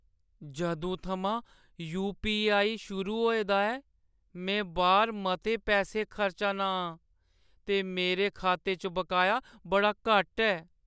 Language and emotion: Dogri, sad